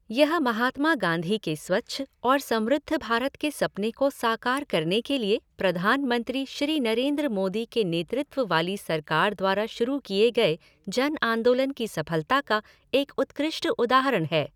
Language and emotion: Hindi, neutral